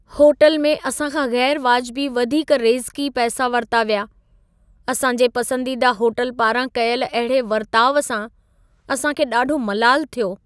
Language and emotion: Sindhi, sad